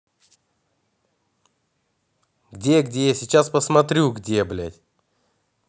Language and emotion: Russian, angry